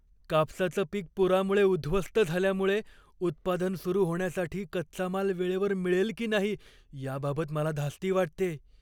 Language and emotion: Marathi, fearful